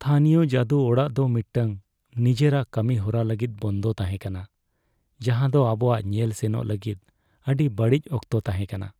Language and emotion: Santali, sad